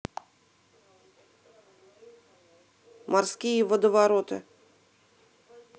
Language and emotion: Russian, neutral